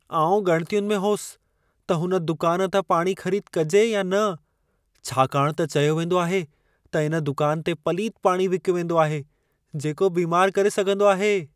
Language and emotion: Sindhi, fearful